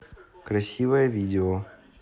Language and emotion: Russian, neutral